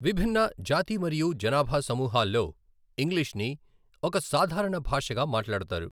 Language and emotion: Telugu, neutral